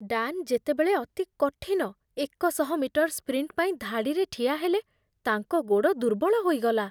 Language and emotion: Odia, fearful